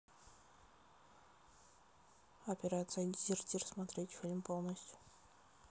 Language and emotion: Russian, neutral